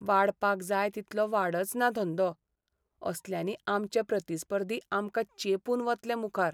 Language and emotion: Goan Konkani, sad